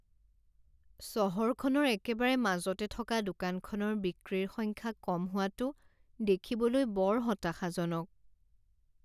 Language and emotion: Assamese, sad